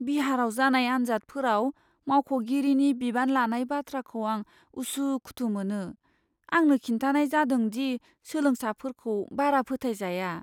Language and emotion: Bodo, fearful